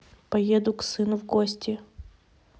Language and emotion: Russian, neutral